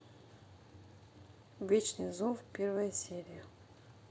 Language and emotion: Russian, neutral